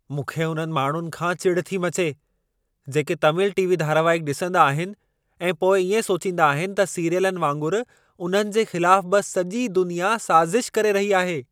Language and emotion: Sindhi, angry